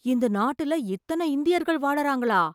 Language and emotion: Tamil, surprised